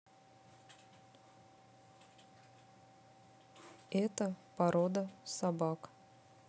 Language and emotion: Russian, neutral